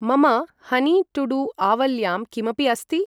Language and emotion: Sanskrit, neutral